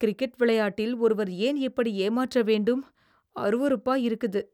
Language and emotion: Tamil, disgusted